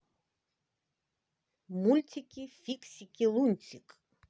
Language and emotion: Russian, positive